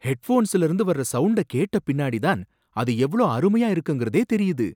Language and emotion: Tamil, surprised